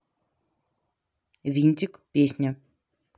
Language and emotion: Russian, neutral